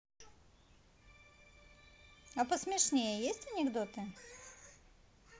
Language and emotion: Russian, neutral